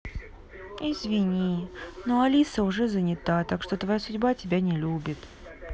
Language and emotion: Russian, sad